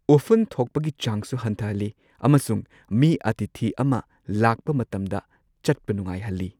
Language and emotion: Manipuri, neutral